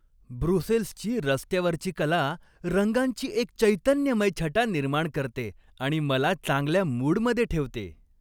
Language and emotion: Marathi, happy